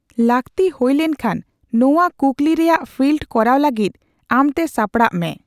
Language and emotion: Santali, neutral